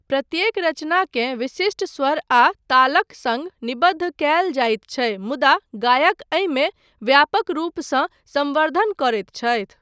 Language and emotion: Maithili, neutral